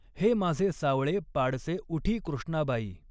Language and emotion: Marathi, neutral